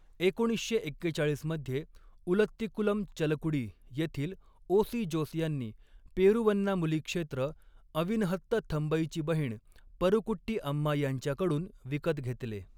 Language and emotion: Marathi, neutral